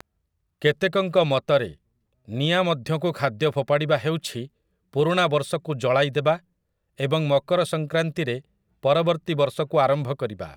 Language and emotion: Odia, neutral